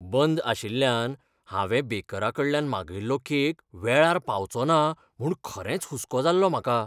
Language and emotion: Goan Konkani, fearful